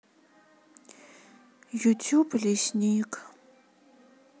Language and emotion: Russian, sad